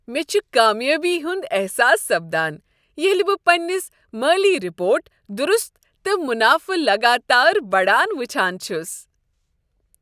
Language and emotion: Kashmiri, happy